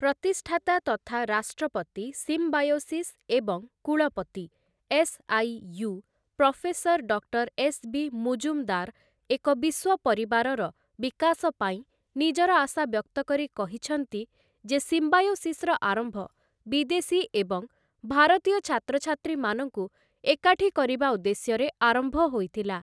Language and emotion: Odia, neutral